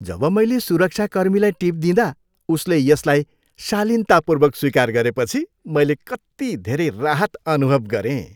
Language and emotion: Nepali, happy